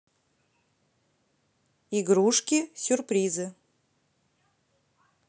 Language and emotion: Russian, neutral